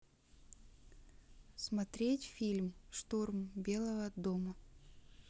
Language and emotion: Russian, neutral